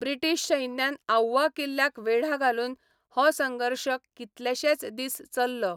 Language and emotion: Goan Konkani, neutral